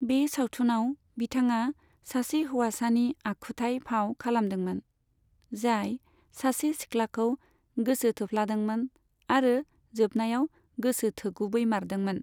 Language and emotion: Bodo, neutral